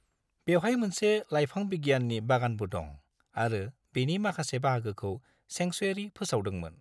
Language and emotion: Bodo, neutral